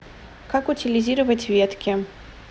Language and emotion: Russian, neutral